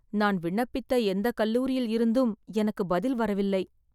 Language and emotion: Tamil, sad